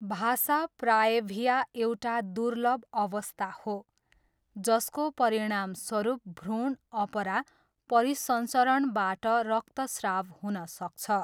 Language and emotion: Nepali, neutral